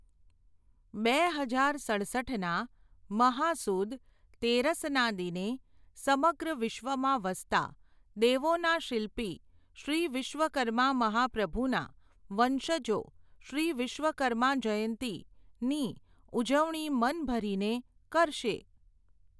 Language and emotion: Gujarati, neutral